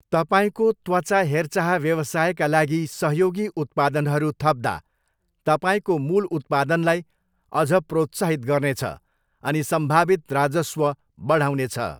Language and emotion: Nepali, neutral